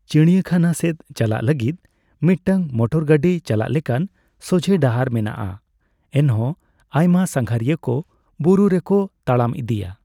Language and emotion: Santali, neutral